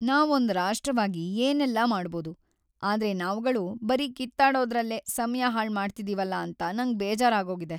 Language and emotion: Kannada, sad